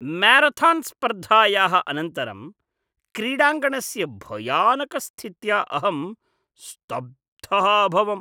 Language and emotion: Sanskrit, disgusted